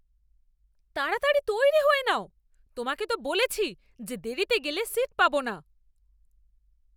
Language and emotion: Bengali, angry